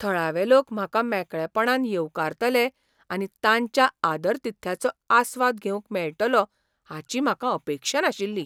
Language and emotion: Goan Konkani, surprised